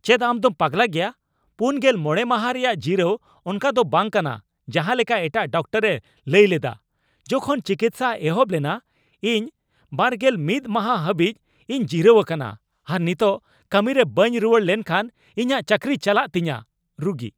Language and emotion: Santali, angry